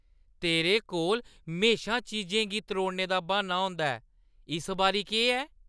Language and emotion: Dogri, disgusted